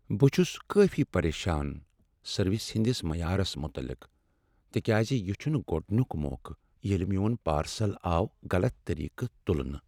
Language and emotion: Kashmiri, sad